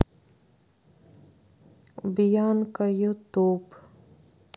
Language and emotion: Russian, sad